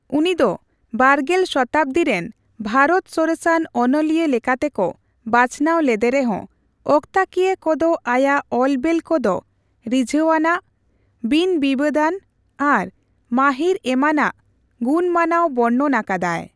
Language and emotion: Santali, neutral